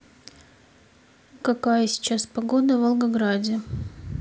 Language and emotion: Russian, neutral